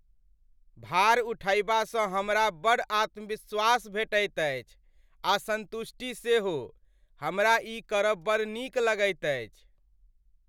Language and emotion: Maithili, happy